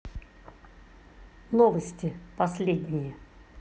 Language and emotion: Russian, neutral